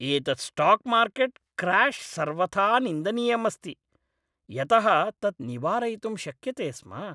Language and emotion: Sanskrit, angry